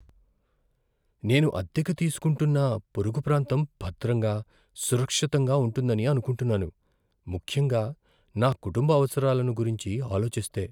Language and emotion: Telugu, fearful